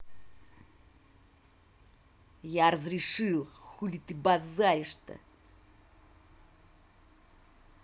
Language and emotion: Russian, angry